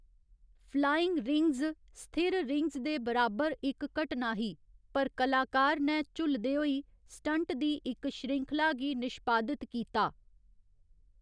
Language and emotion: Dogri, neutral